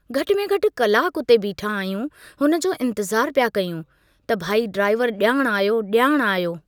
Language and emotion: Sindhi, neutral